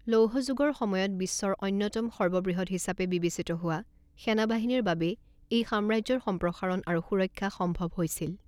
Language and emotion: Assamese, neutral